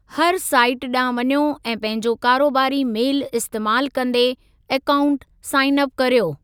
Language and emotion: Sindhi, neutral